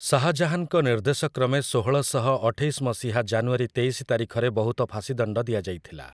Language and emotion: Odia, neutral